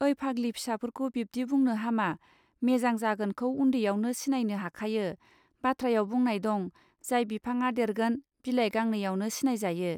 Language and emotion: Bodo, neutral